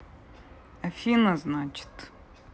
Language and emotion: Russian, neutral